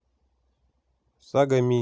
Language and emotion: Russian, neutral